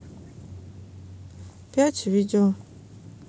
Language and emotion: Russian, neutral